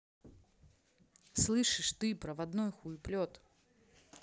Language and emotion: Russian, angry